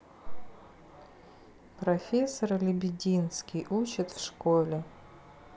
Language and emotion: Russian, sad